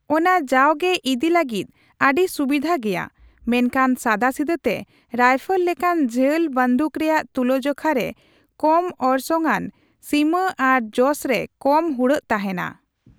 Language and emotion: Santali, neutral